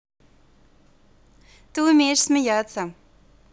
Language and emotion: Russian, positive